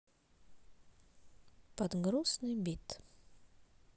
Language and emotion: Russian, sad